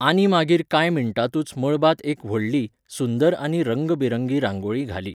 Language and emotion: Goan Konkani, neutral